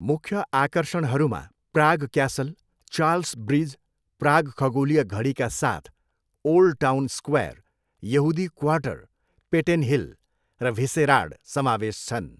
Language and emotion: Nepali, neutral